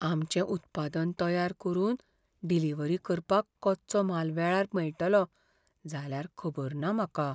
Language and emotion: Goan Konkani, fearful